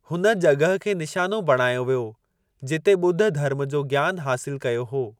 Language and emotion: Sindhi, neutral